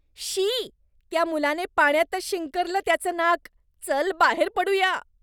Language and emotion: Marathi, disgusted